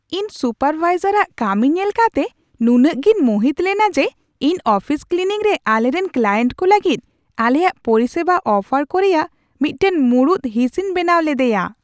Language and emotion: Santali, surprised